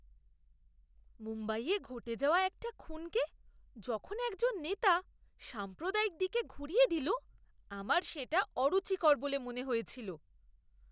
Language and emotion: Bengali, disgusted